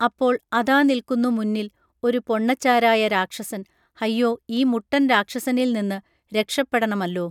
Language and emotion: Malayalam, neutral